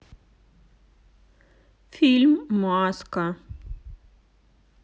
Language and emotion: Russian, sad